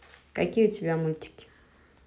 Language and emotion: Russian, neutral